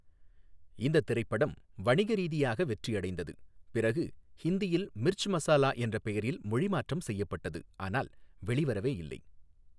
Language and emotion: Tamil, neutral